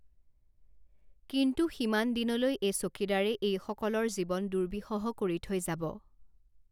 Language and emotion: Assamese, neutral